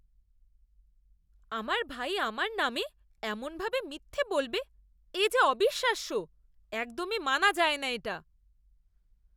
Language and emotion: Bengali, disgusted